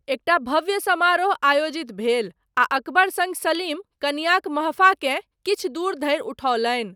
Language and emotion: Maithili, neutral